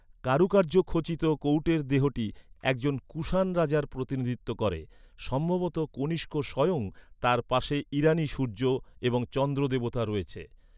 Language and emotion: Bengali, neutral